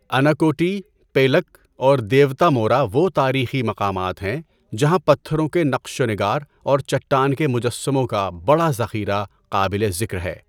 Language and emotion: Urdu, neutral